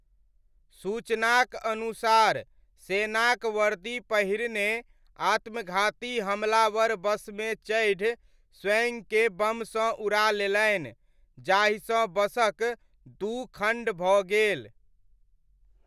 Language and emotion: Maithili, neutral